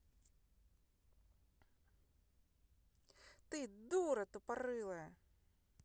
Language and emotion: Russian, angry